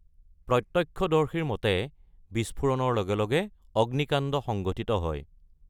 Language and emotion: Assamese, neutral